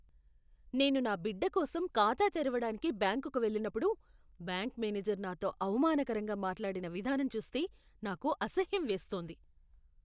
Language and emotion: Telugu, disgusted